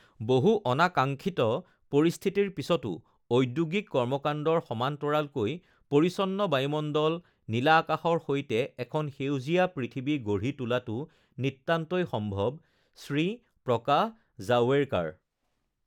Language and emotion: Assamese, neutral